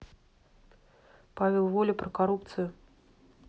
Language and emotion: Russian, neutral